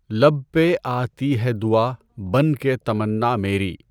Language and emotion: Urdu, neutral